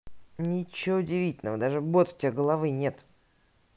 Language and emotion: Russian, neutral